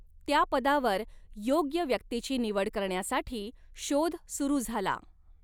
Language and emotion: Marathi, neutral